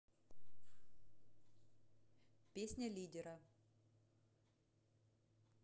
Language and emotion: Russian, neutral